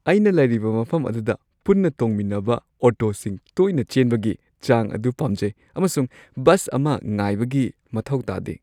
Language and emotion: Manipuri, happy